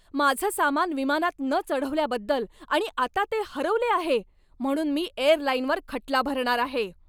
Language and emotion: Marathi, angry